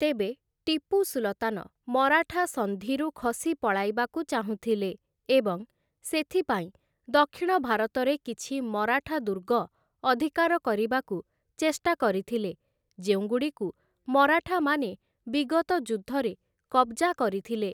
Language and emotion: Odia, neutral